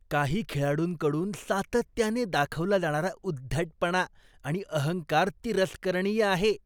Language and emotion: Marathi, disgusted